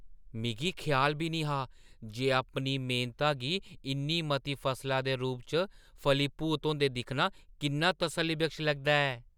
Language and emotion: Dogri, surprised